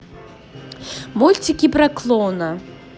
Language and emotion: Russian, positive